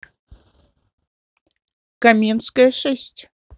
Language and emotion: Russian, neutral